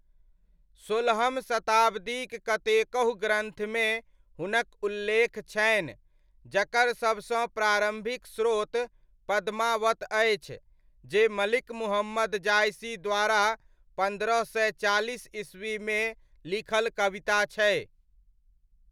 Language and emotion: Maithili, neutral